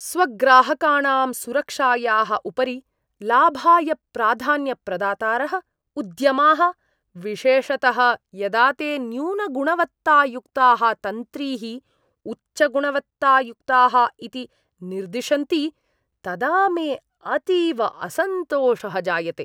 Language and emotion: Sanskrit, disgusted